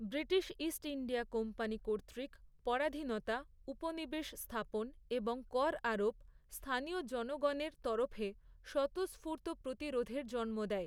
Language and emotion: Bengali, neutral